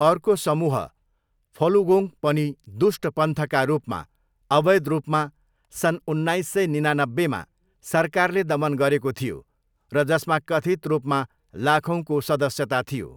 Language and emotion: Nepali, neutral